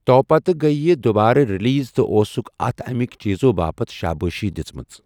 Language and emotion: Kashmiri, neutral